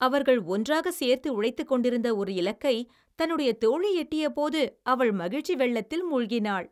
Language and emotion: Tamil, happy